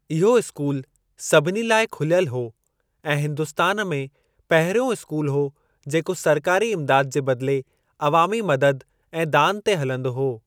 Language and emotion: Sindhi, neutral